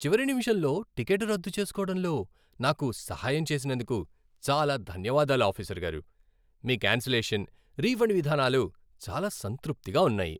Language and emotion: Telugu, happy